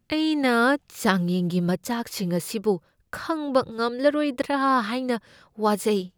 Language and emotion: Manipuri, fearful